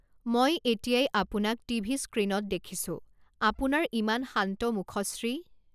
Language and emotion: Assamese, neutral